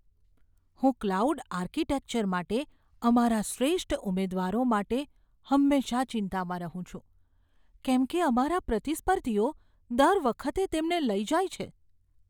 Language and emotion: Gujarati, fearful